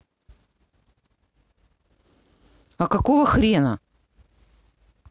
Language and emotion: Russian, angry